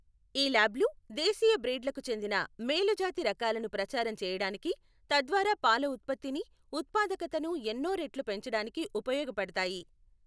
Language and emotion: Telugu, neutral